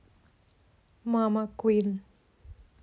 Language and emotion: Russian, neutral